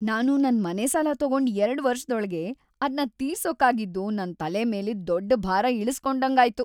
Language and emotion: Kannada, happy